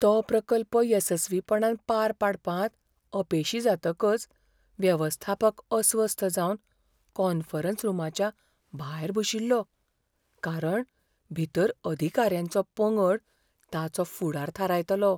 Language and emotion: Goan Konkani, fearful